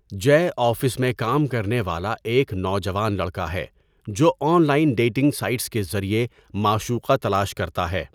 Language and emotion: Urdu, neutral